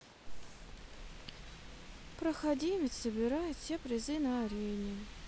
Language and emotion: Russian, sad